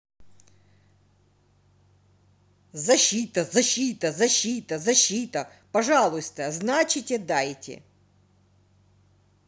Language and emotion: Russian, angry